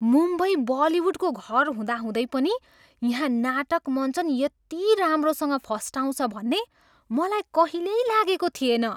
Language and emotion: Nepali, surprised